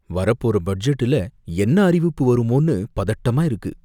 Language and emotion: Tamil, fearful